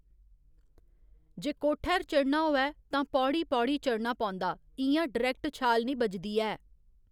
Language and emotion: Dogri, neutral